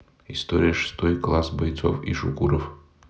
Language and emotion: Russian, neutral